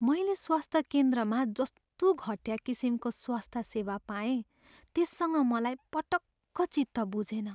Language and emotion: Nepali, sad